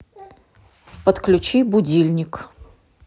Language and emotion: Russian, neutral